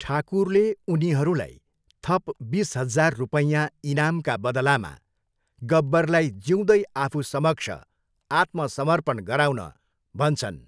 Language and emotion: Nepali, neutral